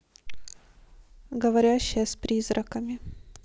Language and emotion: Russian, neutral